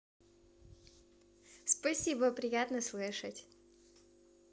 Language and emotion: Russian, positive